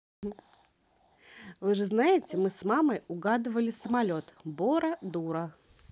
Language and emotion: Russian, positive